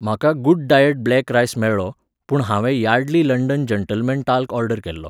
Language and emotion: Goan Konkani, neutral